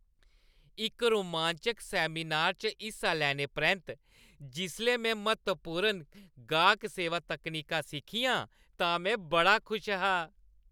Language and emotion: Dogri, happy